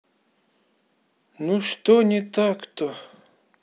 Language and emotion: Russian, sad